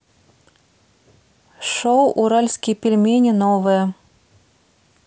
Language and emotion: Russian, neutral